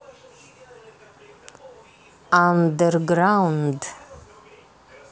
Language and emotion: Russian, neutral